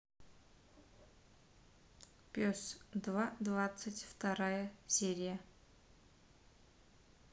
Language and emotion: Russian, neutral